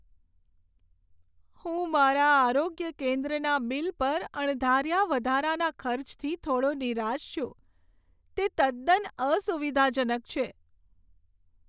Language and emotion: Gujarati, sad